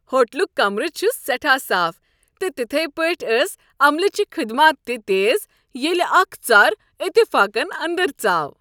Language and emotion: Kashmiri, happy